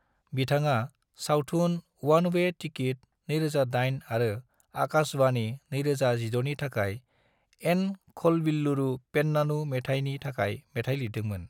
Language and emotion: Bodo, neutral